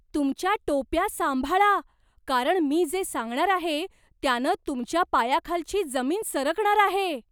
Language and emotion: Marathi, surprised